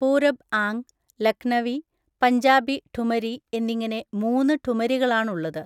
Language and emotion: Malayalam, neutral